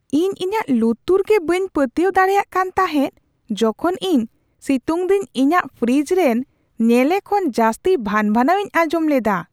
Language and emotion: Santali, surprised